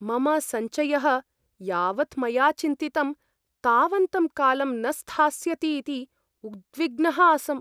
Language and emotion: Sanskrit, fearful